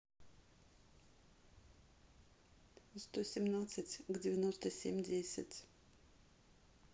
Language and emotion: Russian, neutral